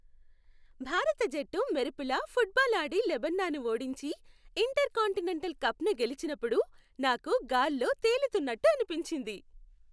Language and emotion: Telugu, happy